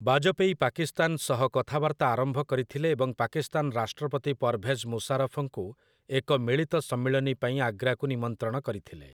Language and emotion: Odia, neutral